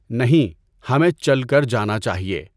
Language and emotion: Urdu, neutral